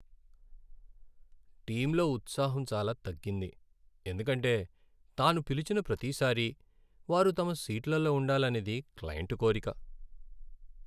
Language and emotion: Telugu, sad